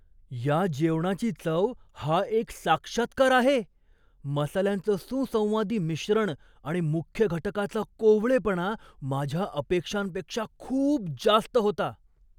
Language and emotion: Marathi, surprised